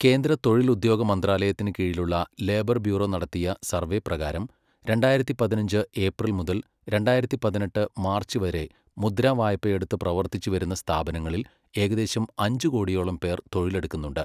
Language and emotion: Malayalam, neutral